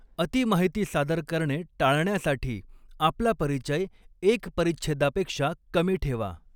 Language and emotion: Marathi, neutral